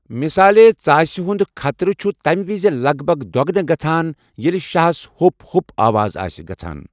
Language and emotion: Kashmiri, neutral